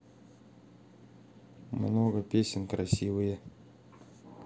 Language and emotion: Russian, neutral